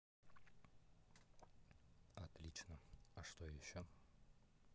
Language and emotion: Russian, neutral